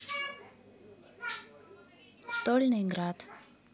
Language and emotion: Russian, neutral